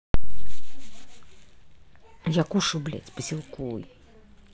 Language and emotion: Russian, angry